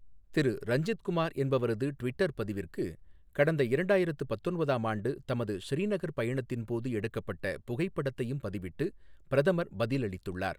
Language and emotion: Tamil, neutral